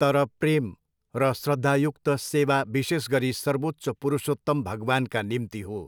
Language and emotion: Nepali, neutral